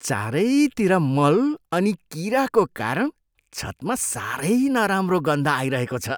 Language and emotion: Nepali, disgusted